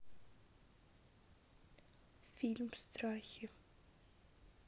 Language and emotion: Russian, sad